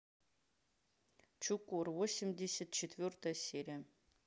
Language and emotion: Russian, neutral